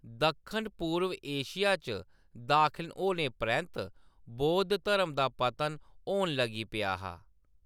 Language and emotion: Dogri, neutral